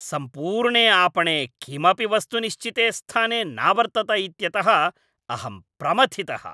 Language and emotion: Sanskrit, angry